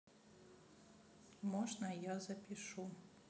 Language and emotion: Russian, sad